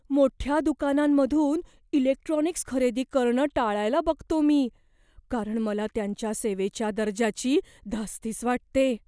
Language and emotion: Marathi, fearful